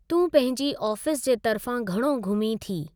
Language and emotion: Sindhi, neutral